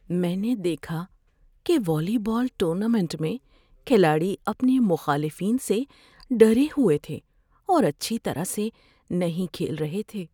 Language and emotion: Urdu, fearful